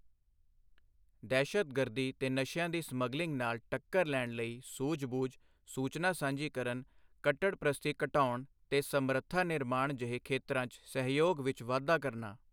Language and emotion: Punjabi, neutral